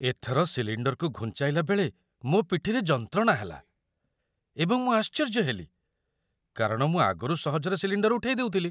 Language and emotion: Odia, surprised